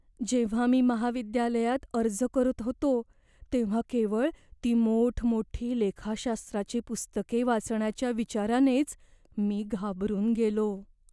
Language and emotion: Marathi, fearful